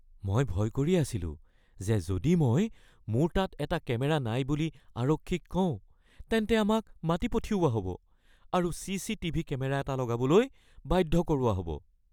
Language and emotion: Assamese, fearful